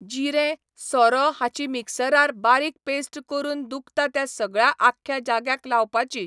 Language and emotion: Goan Konkani, neutral